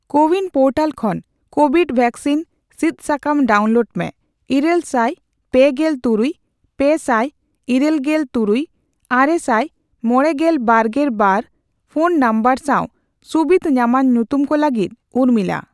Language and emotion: Santali, neutral